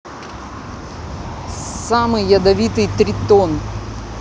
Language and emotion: Russian, neutral